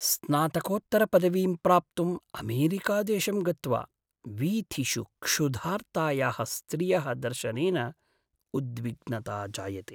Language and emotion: Sanskrit, sad